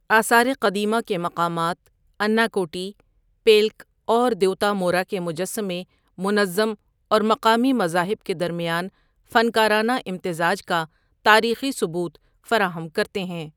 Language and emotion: Urdu, neutral